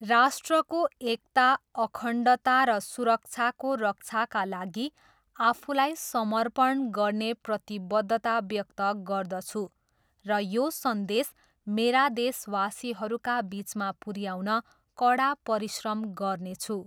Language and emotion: Nepali, neutral